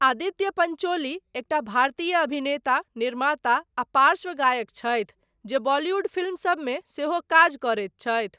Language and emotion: Maithili, neutral